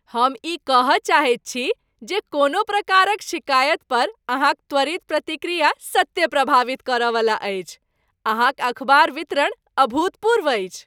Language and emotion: Maithili, happy